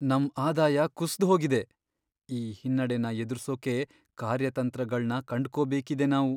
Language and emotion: Kannada, sad